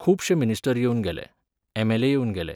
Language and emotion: Goan Konkani, neutral